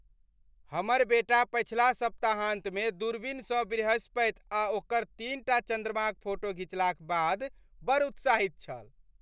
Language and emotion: Maithili, happy